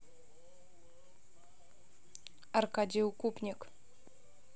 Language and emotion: Russian, neutral